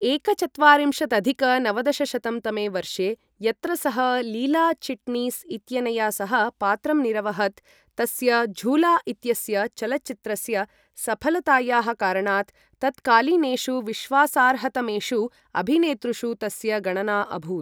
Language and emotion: Sanskrit, neutral